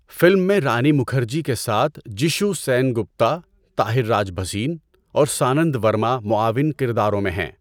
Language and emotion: Urdu, neutral